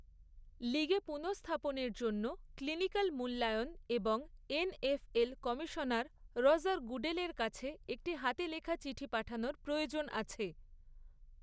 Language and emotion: Bengali, neutral